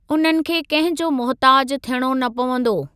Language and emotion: Sindhi, neutral